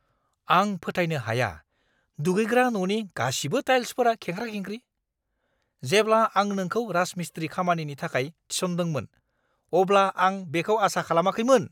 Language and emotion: Bodo, angry